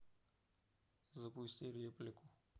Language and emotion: Russian, neutral